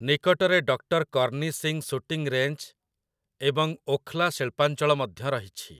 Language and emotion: Odia, neutral